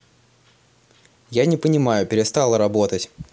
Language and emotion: Russian, angry